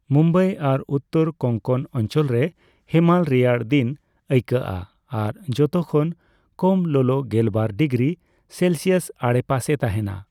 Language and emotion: Santali, neutral